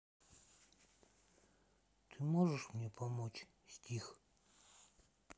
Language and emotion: Russian, sad